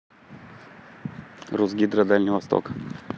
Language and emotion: Russian, neutral